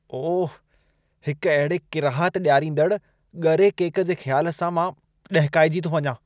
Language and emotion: Sindhi, disgusted